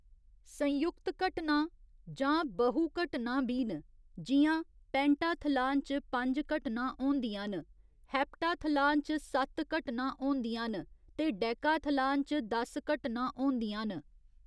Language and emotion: Dogri, neutral